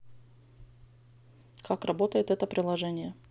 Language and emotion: Russian, neutral